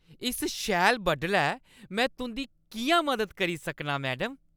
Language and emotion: Dogri, happy